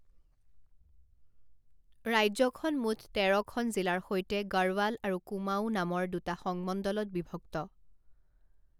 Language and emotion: Assamese, neutral